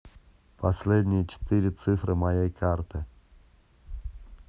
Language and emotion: Russian, neutral